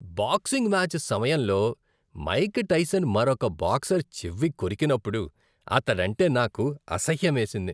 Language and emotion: Telugu, disgusted